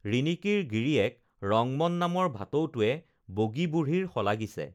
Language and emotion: Assamese, neutral